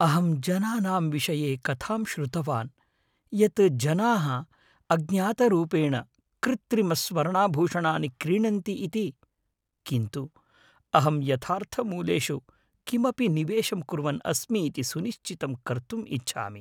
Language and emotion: Sanskrit, fearful